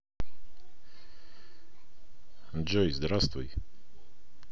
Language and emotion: Russian, neutral